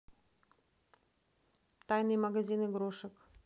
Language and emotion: Russian, neutral